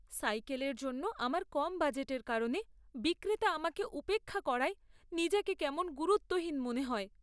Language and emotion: Bengali, sad